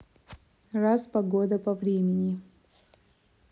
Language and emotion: Russian, neutral